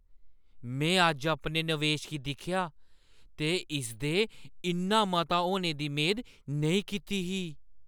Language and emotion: Dogri, surprised